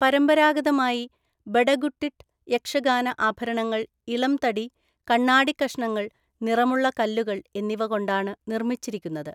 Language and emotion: Malayalam, neutral